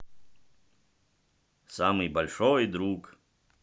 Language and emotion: Russian, positive